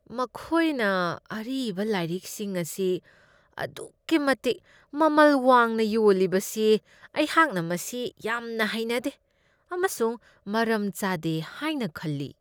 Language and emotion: Manipuri, disgusted